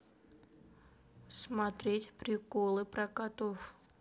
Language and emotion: Russian, neutral